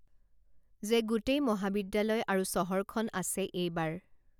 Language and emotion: Assamese, neutral